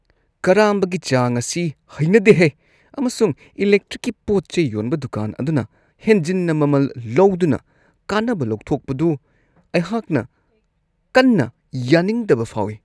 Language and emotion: Manipuri, disgusted